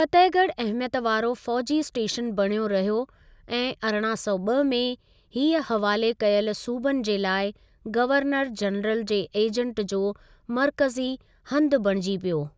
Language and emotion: Sindhi, neutral